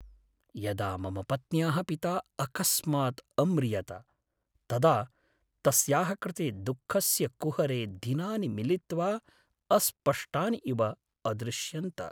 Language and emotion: Sanskrit, sad